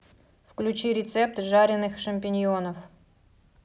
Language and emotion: Russian, neutral